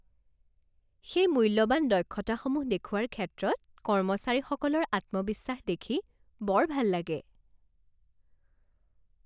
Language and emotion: Assamese, happy